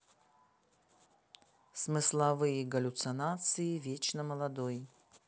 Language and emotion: Russian, neutral